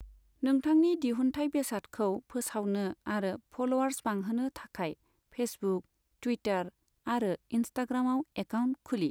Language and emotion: Bodo, neutral